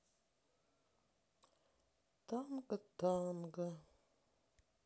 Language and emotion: Russian, sad